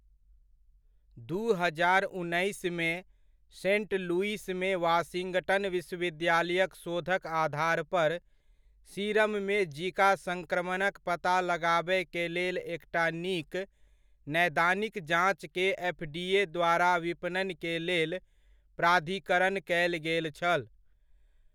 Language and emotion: Maithili, neutral